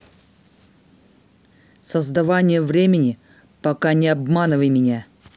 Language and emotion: Russian, angry